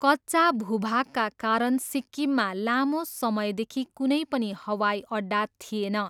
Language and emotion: Nepali, neutral